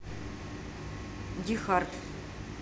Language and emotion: Russian, neutral